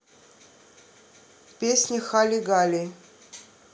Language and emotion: Russian, neutral